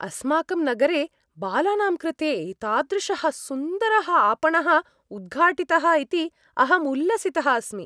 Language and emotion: Sanskrit, happy